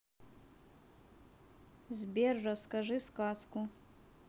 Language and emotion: Russian, neutral